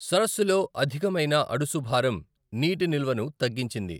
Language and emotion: Telugu, neutral